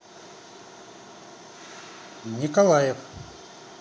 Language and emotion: Russian, neutral